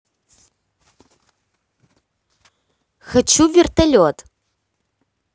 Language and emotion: Russian, neutral